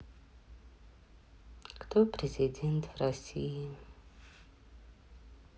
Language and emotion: Russian, sad